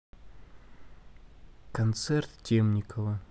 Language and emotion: Russian, neutral